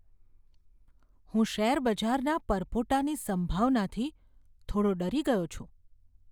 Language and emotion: Gujarati, fearful